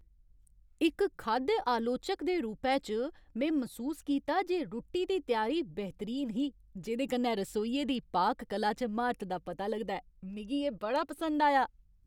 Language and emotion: Dogri, happy